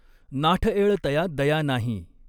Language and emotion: Marathi, neutral